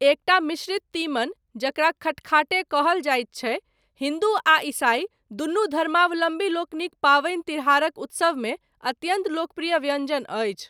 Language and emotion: Maithili, neutral